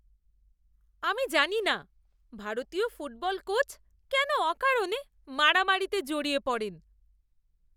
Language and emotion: Bengali, disgusted